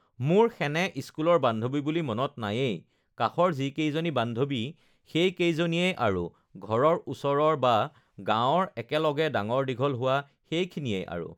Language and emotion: Assamese, neutral